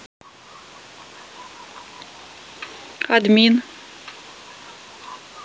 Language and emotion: Russian, neutral